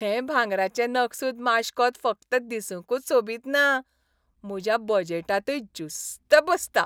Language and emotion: Goan Konkani, happy